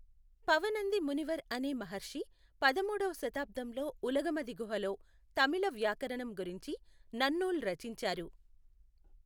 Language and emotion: Telugu, neutral